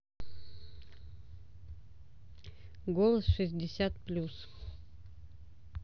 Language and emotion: Russian, neutral